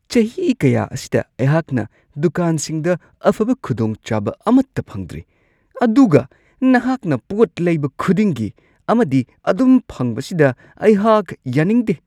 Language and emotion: Manipuri, disgusted